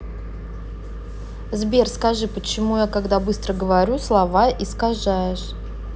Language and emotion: Russian, neutral